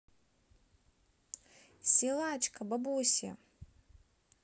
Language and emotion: Russian, positive